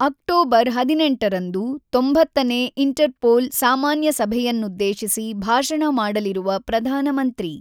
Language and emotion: Kannada, neutral